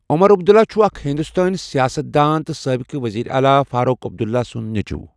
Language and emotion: Kashmiri, neutral